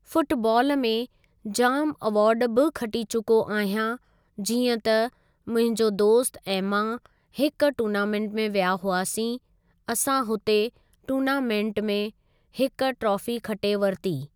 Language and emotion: Sindhi, neutral